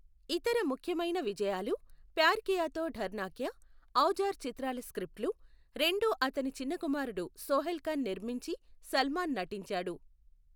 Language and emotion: Telugu, neutral